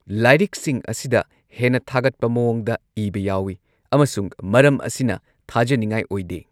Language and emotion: Manipuri, neutral